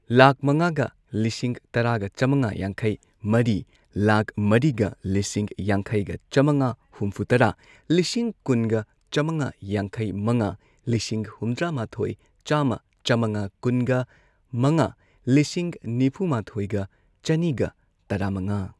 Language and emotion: Manipuri, neutral